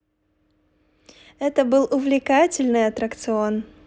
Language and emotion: Russian, positive